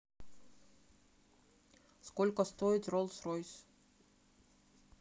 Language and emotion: Russian, neutral